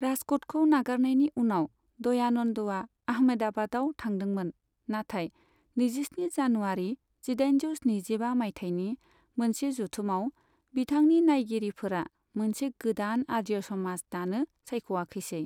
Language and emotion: Bodo, neutral